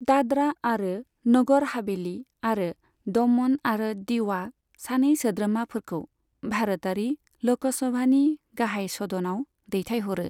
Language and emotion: Bodo, neutral